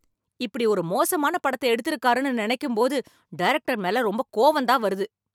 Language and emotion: Tamil, angry